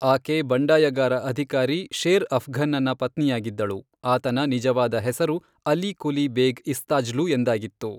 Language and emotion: Kannada, neutral